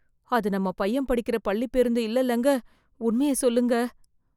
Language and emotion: Tamil, fearful